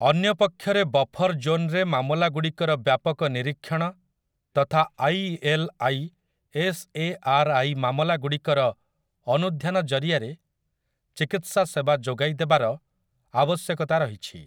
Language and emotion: Odia, neutral